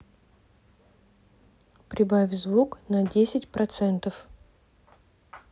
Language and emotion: Russian, neutral